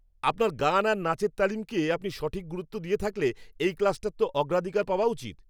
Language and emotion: Bengali, angry